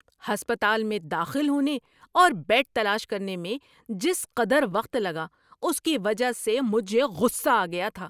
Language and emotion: Urdu, angry